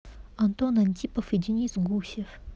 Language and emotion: Russian, neutral